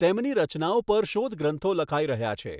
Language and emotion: Gujarati, neutral